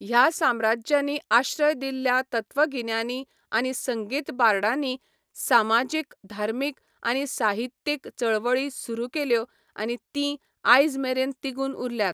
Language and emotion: Goan Konkani, neutral